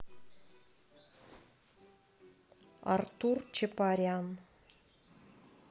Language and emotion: Russian, neutral